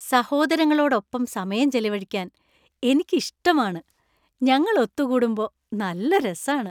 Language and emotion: Malayalam, happy